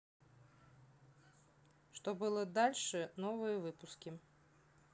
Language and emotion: Russian, neutral